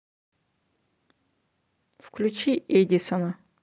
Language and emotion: Russian, neutral